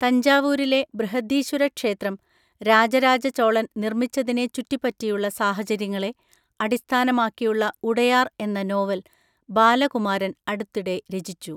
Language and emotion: Malayalam, neutral